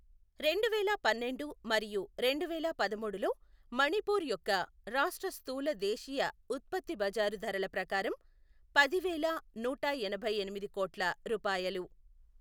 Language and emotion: Telugu, neutral